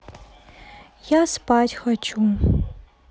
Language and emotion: Russian, sad